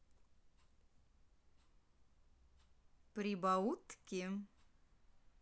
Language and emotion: Russian, positive